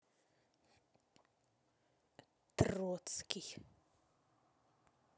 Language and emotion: Russian, angry